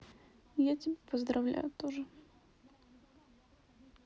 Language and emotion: Russian, sad